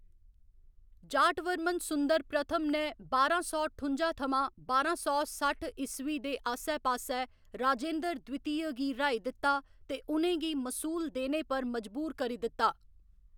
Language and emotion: Dogri, neutral